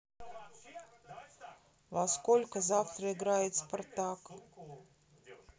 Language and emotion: Russian, neutral